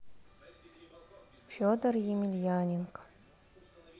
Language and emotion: Russian, sad